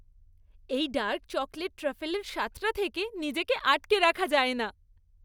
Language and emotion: Bengali, happy